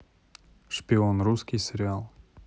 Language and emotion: Russian, neutral